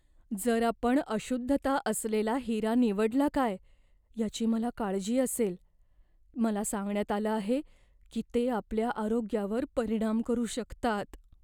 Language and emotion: Marathi, fearful